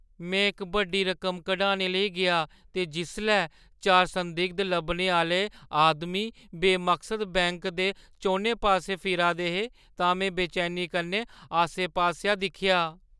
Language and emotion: Dogri, fearful